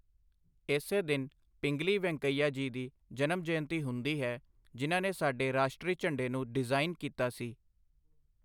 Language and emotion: Punjabi, neutral